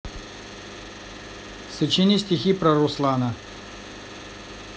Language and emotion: Russian, neutral